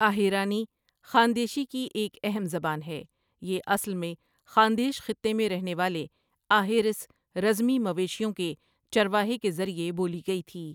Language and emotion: Urdu, neutral